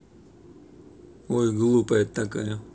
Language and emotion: Russian, neutral